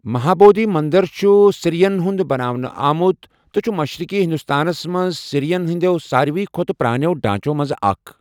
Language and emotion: Kashmiri, neutral